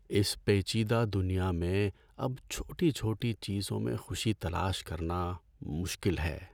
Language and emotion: Urdu, sad